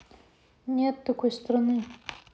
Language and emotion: Russian, neutral